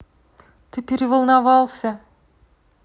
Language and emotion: Russian, neutral